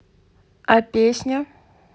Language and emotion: Russian, neutral